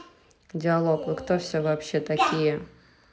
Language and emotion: Russian, neutral